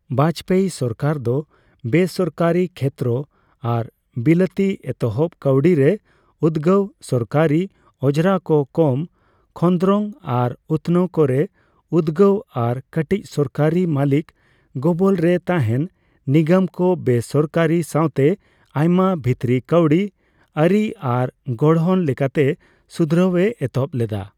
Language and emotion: Santali, neutral